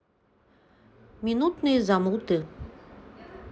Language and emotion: Russian, neutral